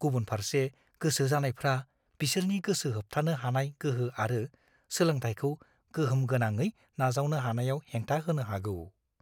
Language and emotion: Bodo, fearful